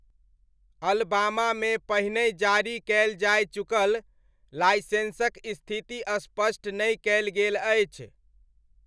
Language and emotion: Maithili, neutral